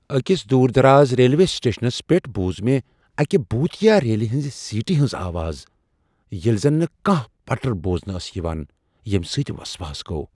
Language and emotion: Kashmiri, fearful